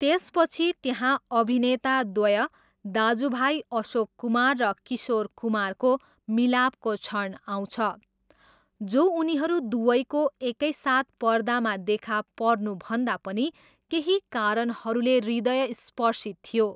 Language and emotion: Nepali, neutral